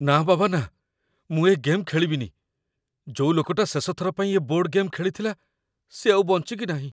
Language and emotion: Odia, fearful